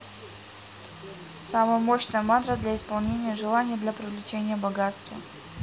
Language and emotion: Russian, neutral